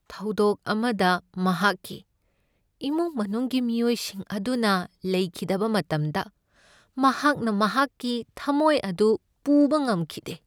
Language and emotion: Manipuri, sad